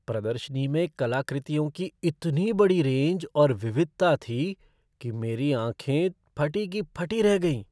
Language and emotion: Hindi, surprised